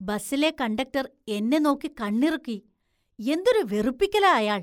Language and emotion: Malayalam, disgusted